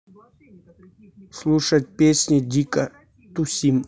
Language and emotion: Russian, neutral